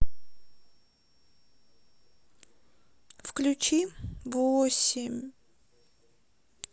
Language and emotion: Russian, sad